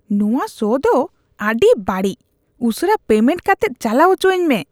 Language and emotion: Santali, disgusted